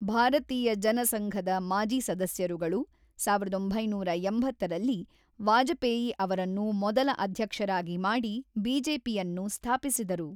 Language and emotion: Kannada, neutral